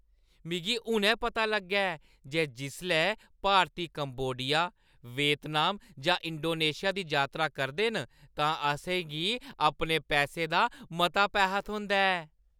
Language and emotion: Dogri, happy